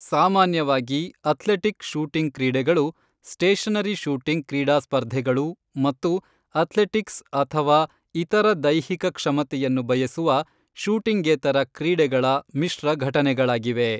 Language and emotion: Kannada, neutral